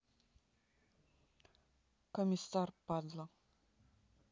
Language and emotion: Russian, neutral